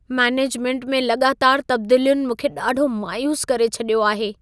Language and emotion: Sindhi, sad